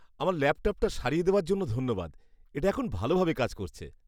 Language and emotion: Bengali, happy